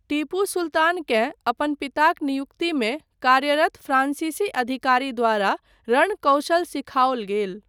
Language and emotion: Maithili, neutral